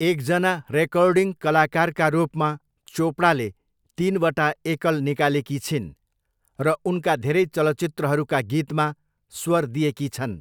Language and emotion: Nepali, neutral